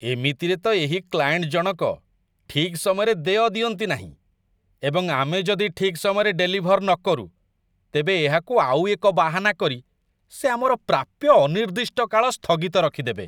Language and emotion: Odia, disgusted